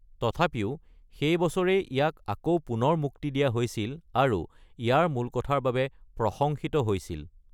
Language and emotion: Assamese, neutral